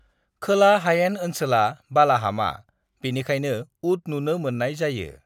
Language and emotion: Bodo, neutral